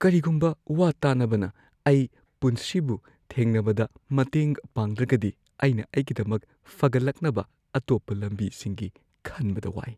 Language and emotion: Manipuri, fearful